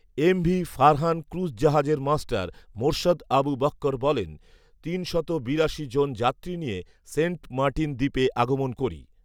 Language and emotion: Bengali, neutral